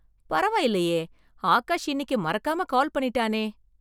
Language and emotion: Tamil, surprised